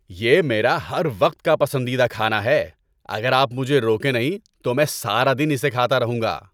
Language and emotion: Urdu, happy